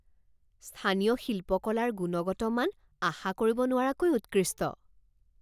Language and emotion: Assamese, surprised